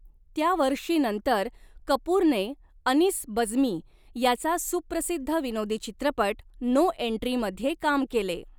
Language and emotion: Marathi, neutral